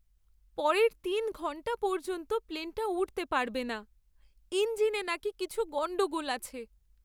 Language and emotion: Bengali, sad